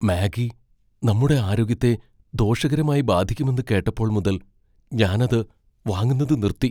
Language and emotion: Malayalam, fearful